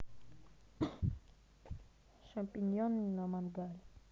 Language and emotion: Russian, neutral